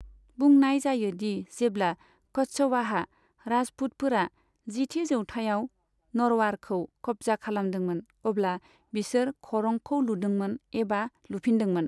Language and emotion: Bodo, neutral